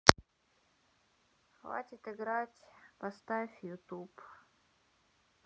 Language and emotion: Russian, sad